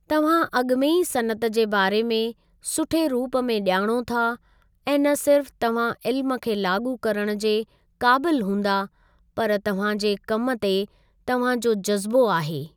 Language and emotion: Sindhi, neutral